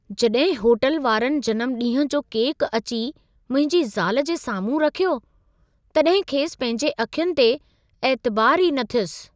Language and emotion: Sindhi, surprised